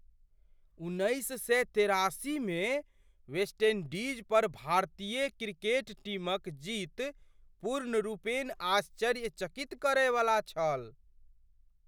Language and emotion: Maithili, surprised